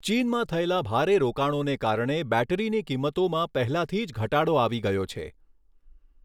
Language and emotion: Gujarati, neutral